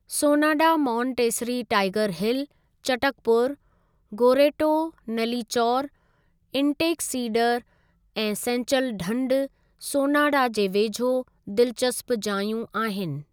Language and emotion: Sindhi, neutral